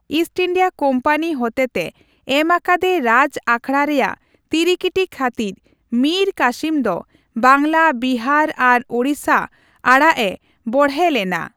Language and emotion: Santali, neutral